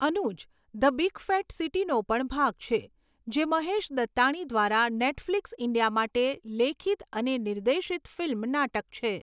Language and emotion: Gujarati, neutral